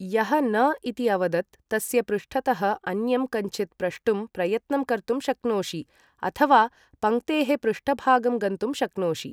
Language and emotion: Sanskrit, neutral